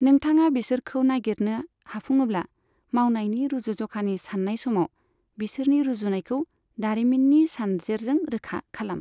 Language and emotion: Bodo, neutral